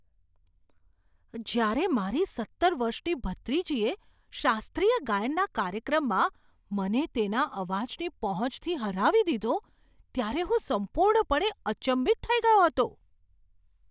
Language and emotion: Gujarati, surprised